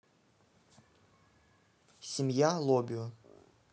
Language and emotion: Russian, neutral